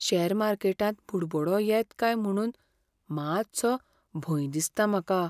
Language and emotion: Goan Konkani, fearful